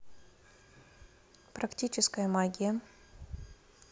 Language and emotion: Russian, neutral